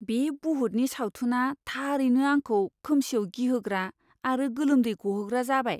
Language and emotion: Bodo, fearful